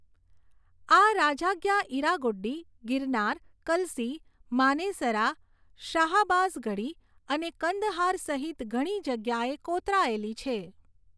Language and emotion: Gujarati, neutral